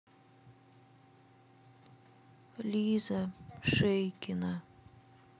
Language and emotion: Russian, neutral